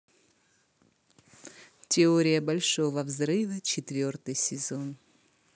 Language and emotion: Russian, positive